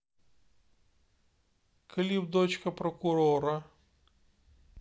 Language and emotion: Russian, neutral